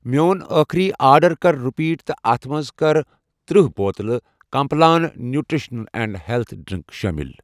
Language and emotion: Kashmiri, neutral